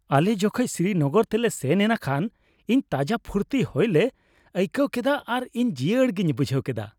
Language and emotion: Santali, happy